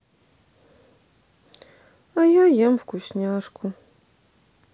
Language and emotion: Russian, sad